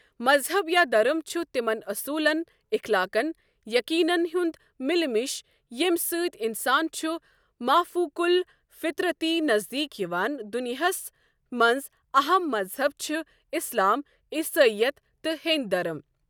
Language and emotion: Kashmiri, neutral